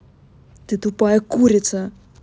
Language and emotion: Russian, angry